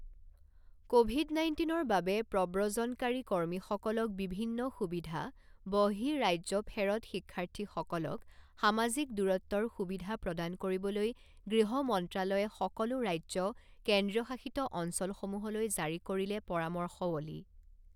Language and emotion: Assamese, neutral